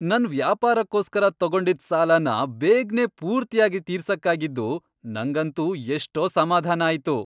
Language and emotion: Kannada, happy